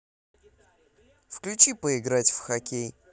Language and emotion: Russian, positive